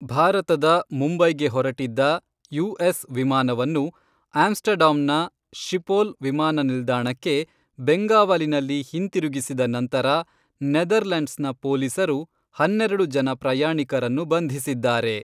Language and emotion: Kannada, neutral